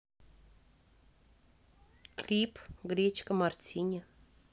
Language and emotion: Russian, neutral